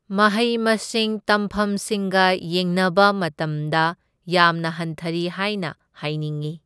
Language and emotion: Manipuri, neutral